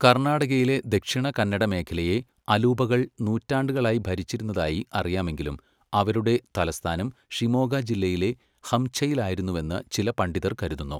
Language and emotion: Malayalam, neutral